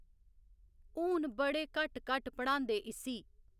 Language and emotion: Dogri, neutral